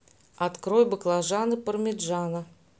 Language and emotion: Russian, neutral